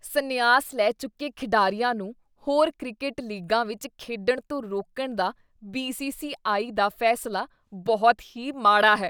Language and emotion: Punjabi, disgusted